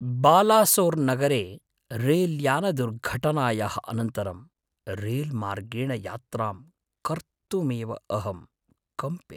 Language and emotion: Sanskrit, fearful